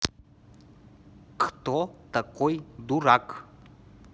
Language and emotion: Russian, neutral